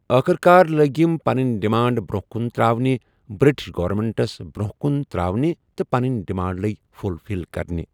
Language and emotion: Kashmiri, neutral